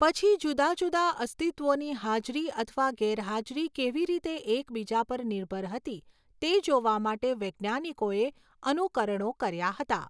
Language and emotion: Gujarati, neutral